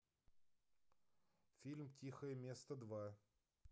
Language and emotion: Russian, neutral